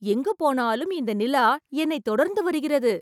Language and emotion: Tamil, surprised